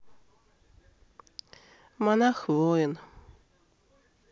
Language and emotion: Russian, sad